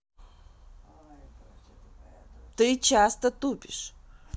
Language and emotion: Russian, neutral